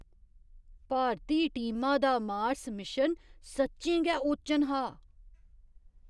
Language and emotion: Dogri, surprised